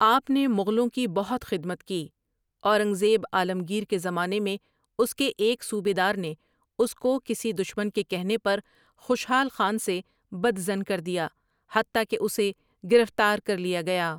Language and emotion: Urdu, neutral